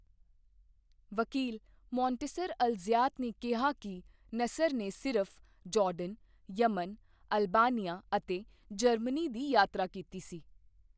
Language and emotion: Punjabi, neutral